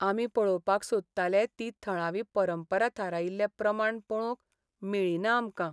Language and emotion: Goan Konkani, sad